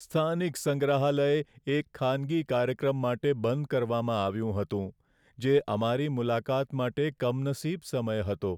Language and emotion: Gujarati, sad